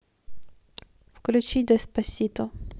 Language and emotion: Russian, neutral